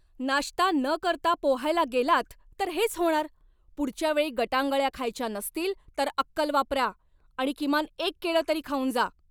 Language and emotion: Marathi, angry